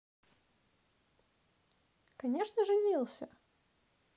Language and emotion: Russian, positive